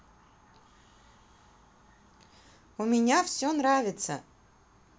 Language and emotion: Russian, positive